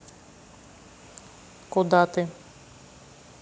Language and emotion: Russian, neutral